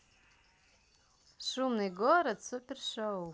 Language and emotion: Russian, positive